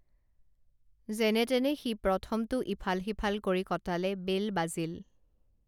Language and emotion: Assamese, neutral